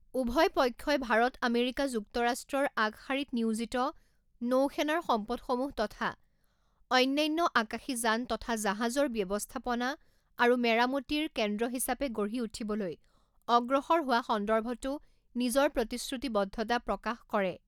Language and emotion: Assamese, neutral